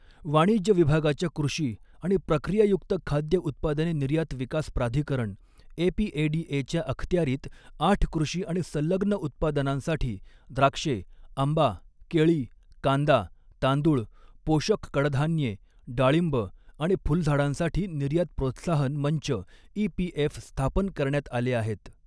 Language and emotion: Marathi, neutral